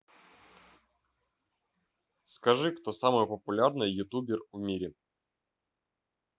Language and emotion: Russian, neutral